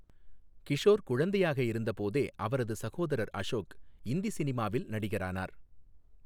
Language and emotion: Tamil, neutral